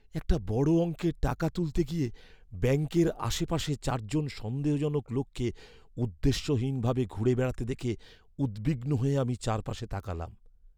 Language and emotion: Bengali, fearful